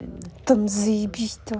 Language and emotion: Russian, angry